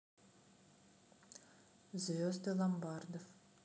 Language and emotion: Russian, neutral